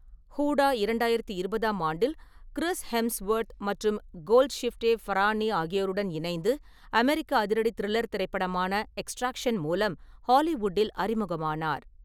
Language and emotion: Tamil, neutral